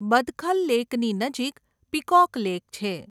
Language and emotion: Gujarati, neutral